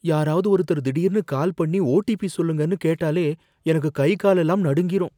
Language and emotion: Tamil, fearful